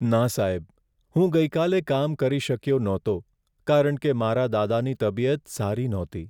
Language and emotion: Gujarati, sad